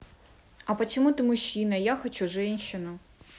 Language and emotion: Russian, neutral